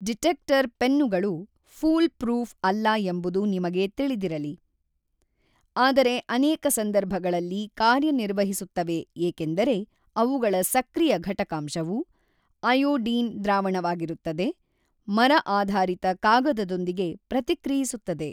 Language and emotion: Kannada, neutral